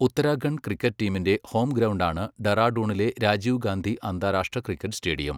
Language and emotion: Malayalam, neutral